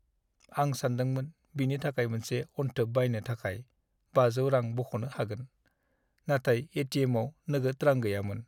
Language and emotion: Bodo, sad